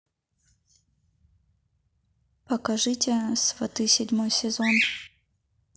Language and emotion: Russian, neutral